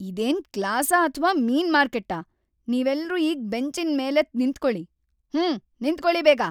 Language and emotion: Kannada, angry